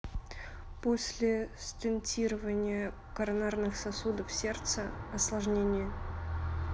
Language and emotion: Russian, neutral